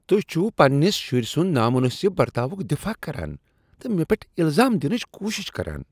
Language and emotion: Kashmiri, disgusted